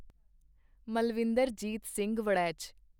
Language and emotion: Punjabi, neutral